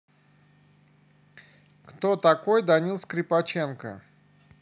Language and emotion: Russian, neutral